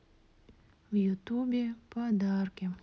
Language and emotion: Russian, sad